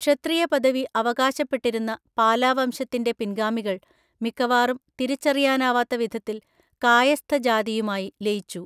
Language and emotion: Malayalam, neutral